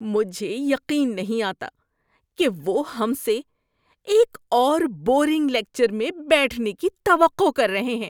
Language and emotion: Urdu, disgusted